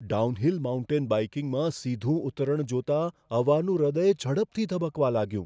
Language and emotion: Gujarati, fearful